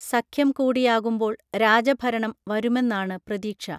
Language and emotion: Malayalam, neutral